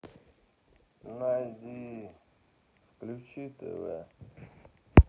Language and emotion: Russian, sad